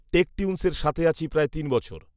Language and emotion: Bengali, neutral